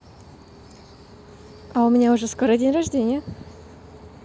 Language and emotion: Russian, positive